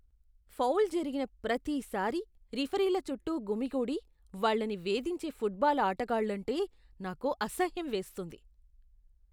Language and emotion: Telugu, disgusted